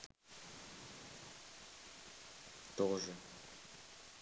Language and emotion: Russian, neutral